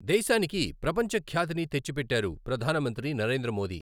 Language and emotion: Telugu, neutral